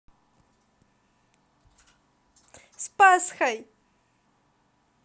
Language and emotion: Russian, positive